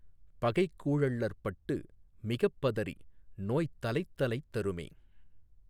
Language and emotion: Tamil, neutral